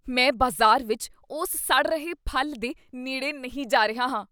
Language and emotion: Punjabi, disgusted